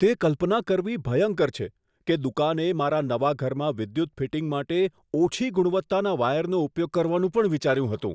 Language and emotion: Gujarati, disgusted